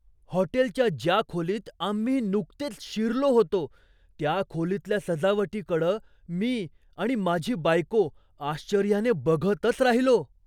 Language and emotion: Marathi, surprised